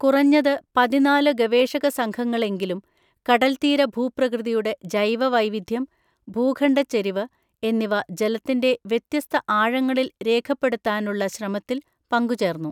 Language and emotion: Malayalam, neutral